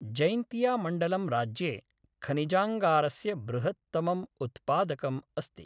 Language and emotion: Sanskrit, neutral